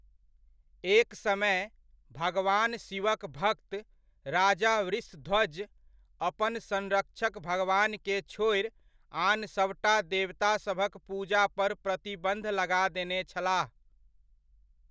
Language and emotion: Maithili, neutral